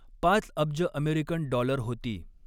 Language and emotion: Marathi, neutral